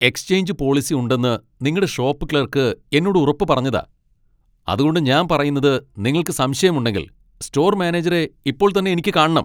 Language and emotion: Malayalam, angry